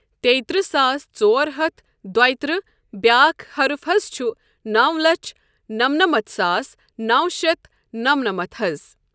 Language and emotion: Kashmiri, neutral